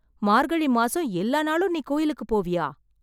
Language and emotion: Tamil, surprised